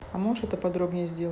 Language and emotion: Russian, neutral